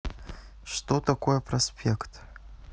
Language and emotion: Russian, neutral